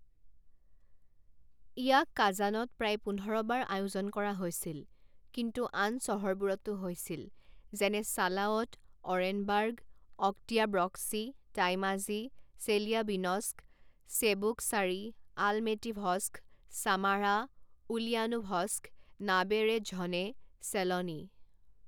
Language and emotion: Assamese, neutral